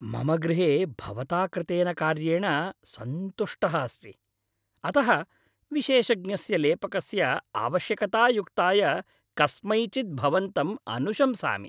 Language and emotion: Sanskrit, happy